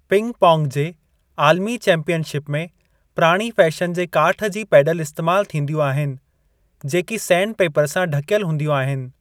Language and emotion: Sindhi, neutral